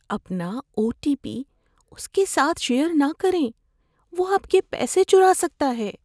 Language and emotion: Urdu, fearful